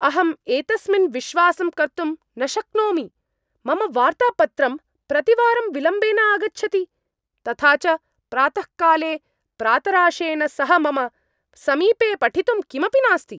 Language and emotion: Sanskrit, angry